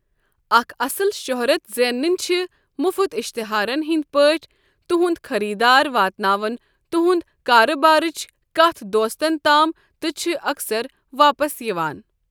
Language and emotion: Kashmiri, neutral